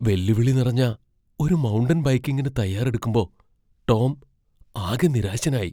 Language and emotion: Malayalam, fearful